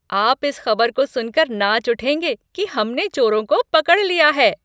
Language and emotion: Hindi, happy